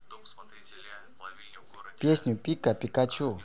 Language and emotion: Russian, neutral